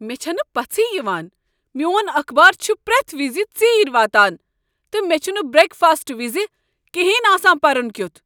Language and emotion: Kashmiri, angry